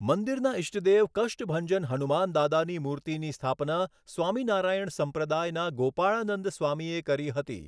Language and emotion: Gujarati, neutral